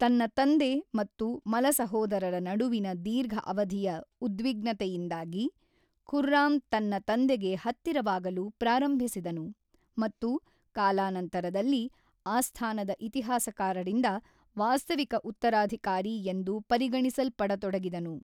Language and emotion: Kannada, neutral